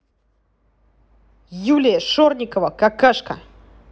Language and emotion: Russian, angry